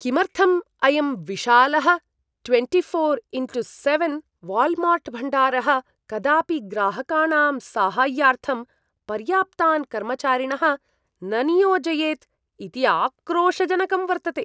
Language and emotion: Sanskrit, disgusted